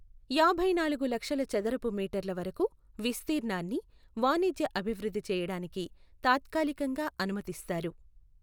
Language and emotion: Telugu, neutral